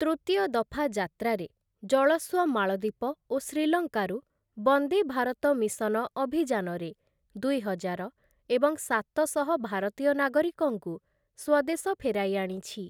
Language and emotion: Odia, neutral